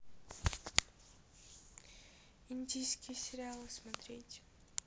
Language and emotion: Russian, neutral